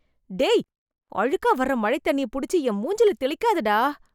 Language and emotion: Tamil, disgusted